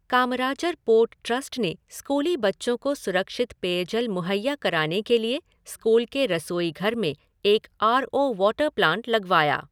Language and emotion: Hindi, neutral